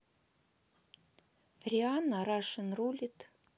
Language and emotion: Russian, neutral